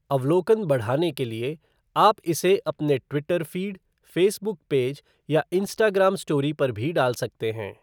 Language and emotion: Hindi, neutral